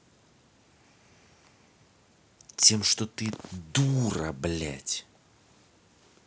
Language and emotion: Russian, angry